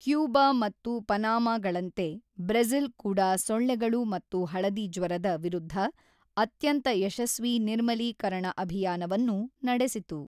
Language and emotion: Kannada, neutral